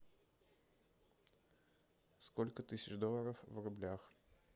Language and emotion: Russian, neutral